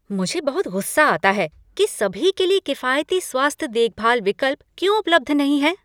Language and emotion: Hindi, angry